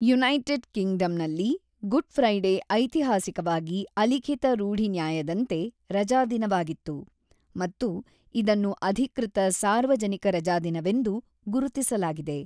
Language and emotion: Kannada, neutral